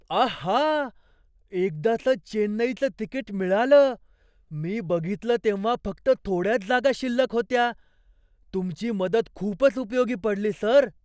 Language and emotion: Marathi, surprised